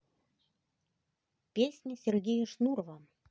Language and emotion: Russian, neutral